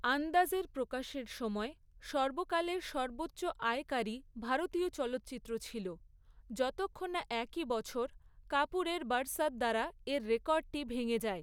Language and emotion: Bengali, neutral